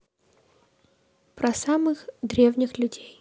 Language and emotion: Russian, neutral